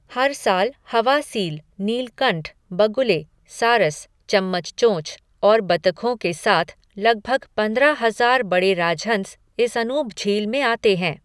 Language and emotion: Hindi, neutral